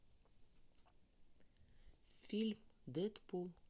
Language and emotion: Russian, neutral